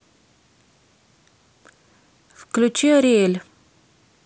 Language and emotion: Russian, neutral